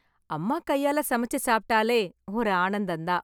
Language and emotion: Tamil, happy